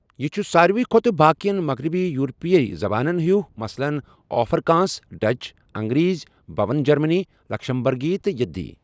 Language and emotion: Kashmiri, neutral